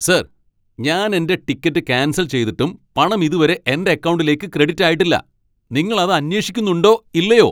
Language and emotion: Malayalam, angry